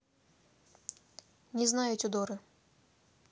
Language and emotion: Russian, neutral